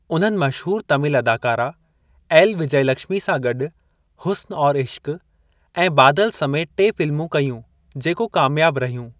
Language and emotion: Sindhi, neutral